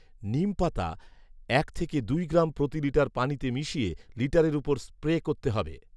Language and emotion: Bengali, neutral